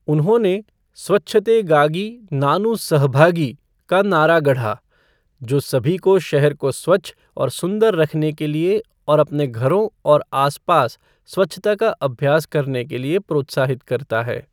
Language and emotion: Hindi, neutral